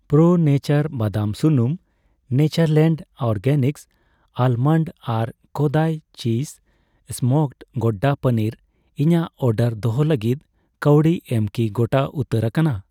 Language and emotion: Santali, neutral